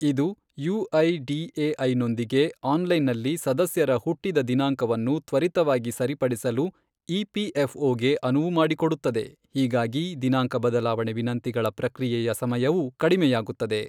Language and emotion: Kannada, neutral